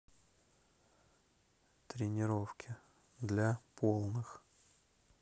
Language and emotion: Russian, neutral